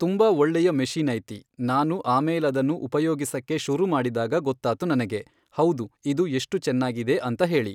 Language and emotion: Kannada, neutral